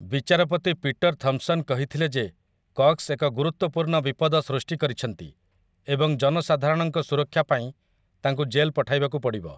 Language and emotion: Odia, neutral